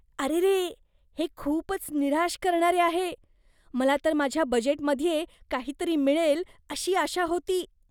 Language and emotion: Marathi, disgusted